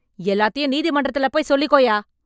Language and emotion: Tamil, angry